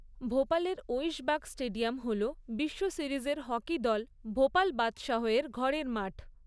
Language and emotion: Bengali, neutral